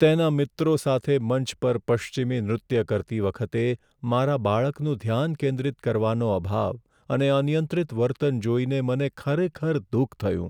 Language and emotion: Gujarati, sad